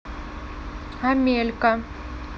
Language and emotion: Russian, neutral